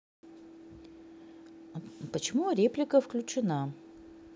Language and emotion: Russian, neutral